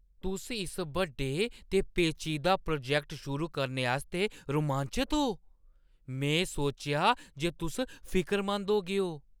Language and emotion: Dogri, surprised